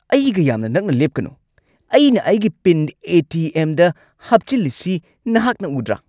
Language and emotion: Manipuri, angry